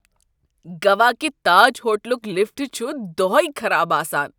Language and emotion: Kashmiri, disgusted